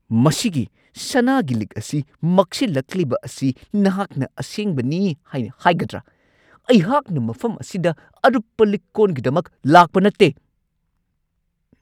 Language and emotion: Manipuri, angry